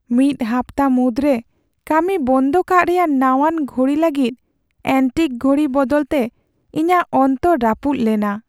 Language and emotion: Santali, sad